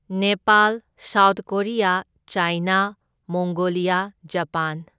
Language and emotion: Manipuri, neutral